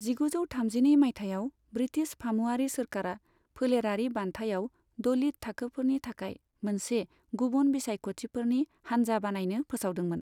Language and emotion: Bodo, neutral